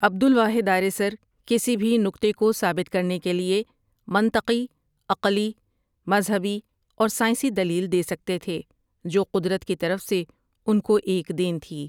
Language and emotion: Urdu, neutral